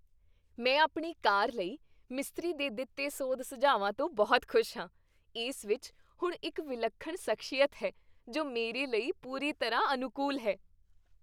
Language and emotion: Punjabi, happy